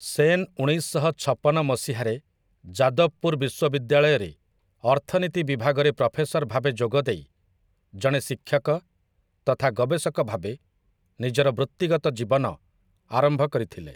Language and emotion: Odia, neutral